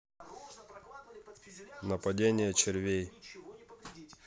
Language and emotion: Russian, neutral